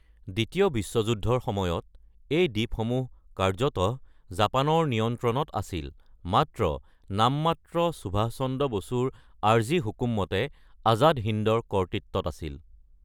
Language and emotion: Assamese, neutral